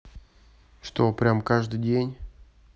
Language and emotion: Russian, neutral